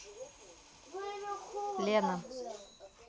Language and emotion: Russian, neutral